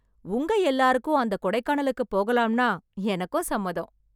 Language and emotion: Tamil, happy